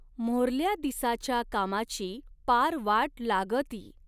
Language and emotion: Marathi, neutral